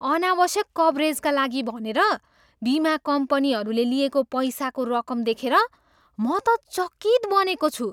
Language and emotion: Nepali, surprised